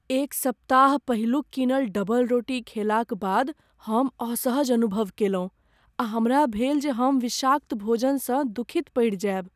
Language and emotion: Maithili, fearful